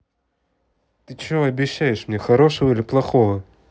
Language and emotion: Russian, neutral